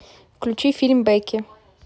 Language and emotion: Russian, neutral